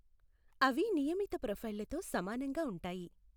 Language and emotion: Telugu, neutral